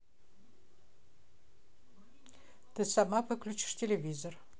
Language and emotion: Russian, neutral